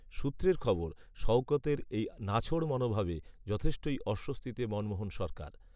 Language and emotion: Bengali, neutral